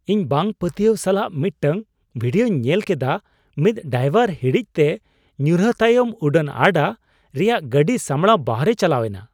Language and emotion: Santali, surprised